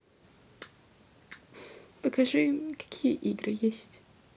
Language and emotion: Russian, sad